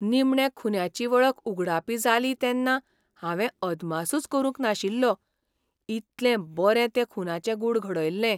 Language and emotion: Goan Konkani, surprised